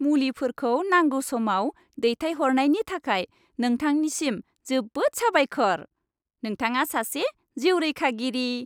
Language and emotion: Bodo, happy